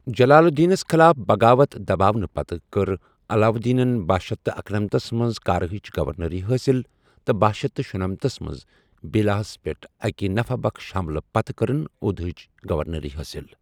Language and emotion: Kashmiri, neutral